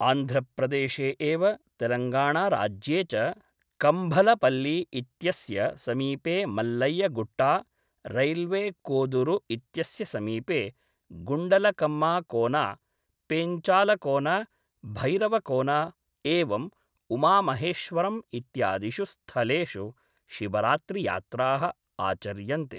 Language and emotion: Sanskrit, neutral